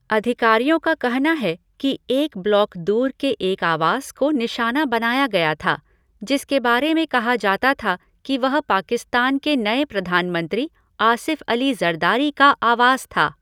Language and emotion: Hindi, neutral